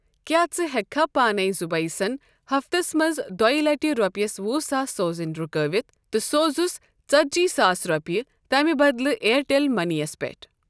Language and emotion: Kashmiri, neutral